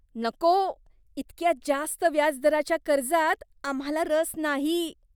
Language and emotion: Marathi, disgusted